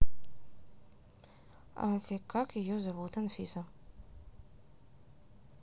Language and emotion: Russian, neutral